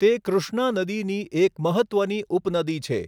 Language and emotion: Gujarati, neutral